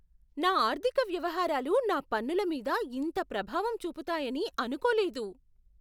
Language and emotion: Telugu, surprised